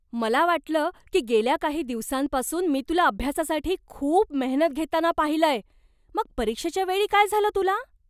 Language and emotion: Marathi, surprised